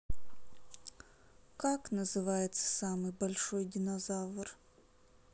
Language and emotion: Russian, sad